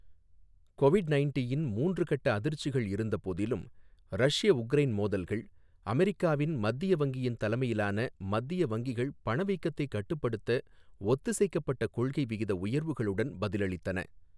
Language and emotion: Tamil, neutral